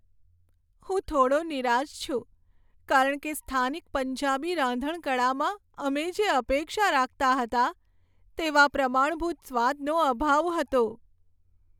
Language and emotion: Gujarati, sad